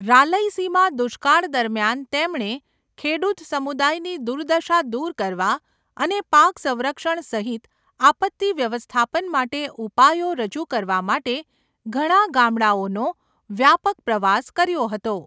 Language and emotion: Gujarati, neutral